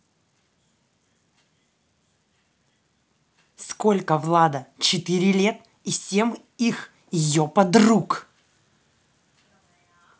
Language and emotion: Russian, angry